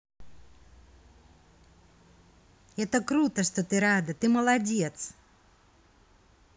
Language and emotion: Russian, positive